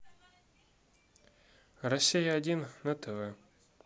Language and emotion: Russian, neutral